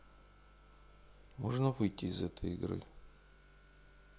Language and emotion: Russian, neutral